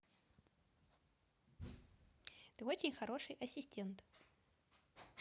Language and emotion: Russian, positive